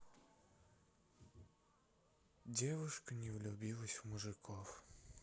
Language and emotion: Russian, sad